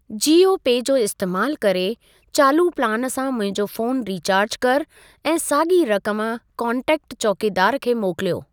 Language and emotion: Sindhi, neutral